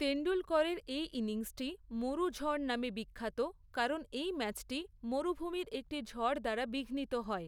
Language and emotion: Bengali, neutral